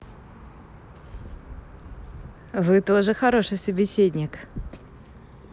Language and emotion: Russian, positive